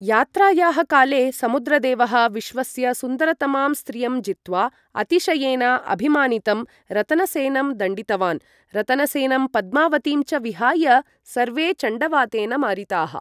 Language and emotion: Sanskrit, neutral